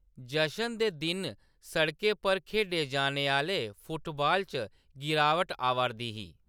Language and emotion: Dogri, neutral